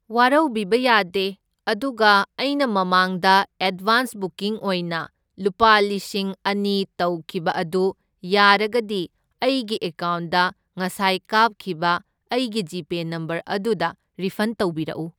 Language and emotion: Manipuri, neutral